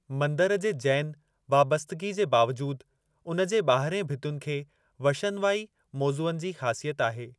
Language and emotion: Sindhi, neutral